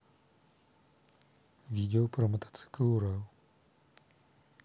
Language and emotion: Russian, neutral